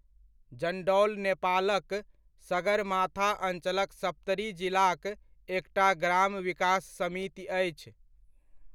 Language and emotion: Maithili, neutral